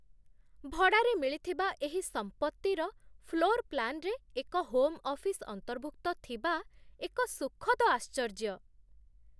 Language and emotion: Odia, surprised